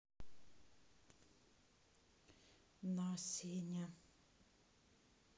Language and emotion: Russian, sad